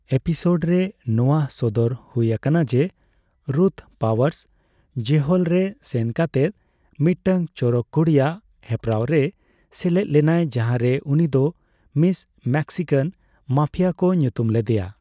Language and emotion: Santali, neutral